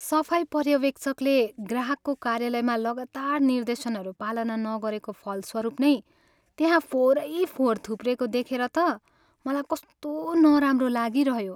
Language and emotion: Nepali, sad